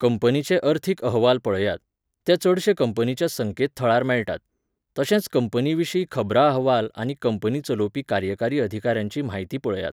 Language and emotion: Goan Konkani, neutral